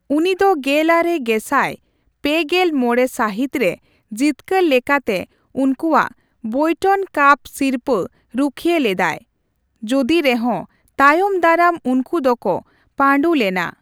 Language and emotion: Santali, neutral